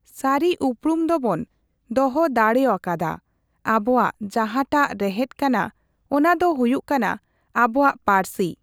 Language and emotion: Santali, neutral